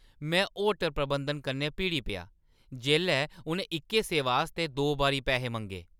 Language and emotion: Dogri, angry